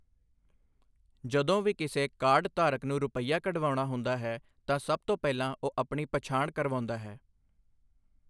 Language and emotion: Punjabi, neutral